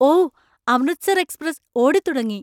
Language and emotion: Malayalam, surprised